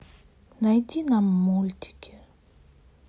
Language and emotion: Russian, sad